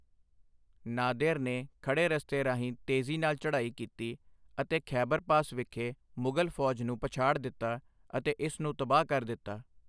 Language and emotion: Punjabi, neutral